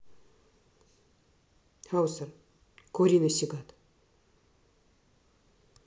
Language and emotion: Russian, neutral